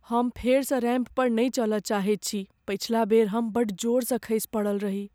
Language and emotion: Maithili, fearful